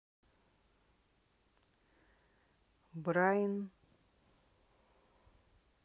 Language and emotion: Russian, neutral